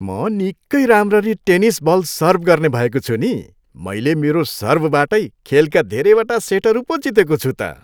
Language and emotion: Nepali, happy